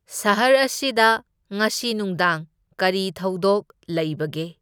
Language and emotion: Manipuri, neutral